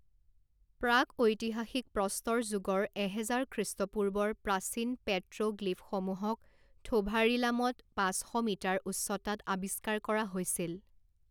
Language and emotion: Assamese, neutral